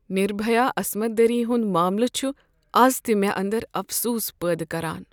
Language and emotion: Kashmiri, sad